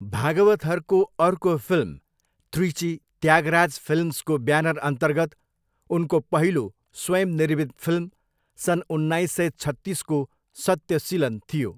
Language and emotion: Nepali, neutral